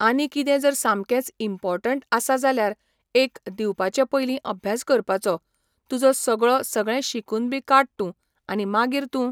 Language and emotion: Goan Konkani, neutral